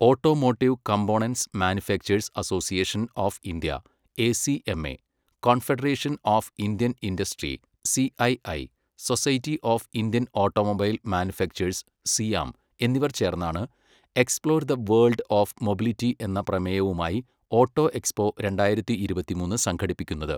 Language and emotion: Malayalam, neutral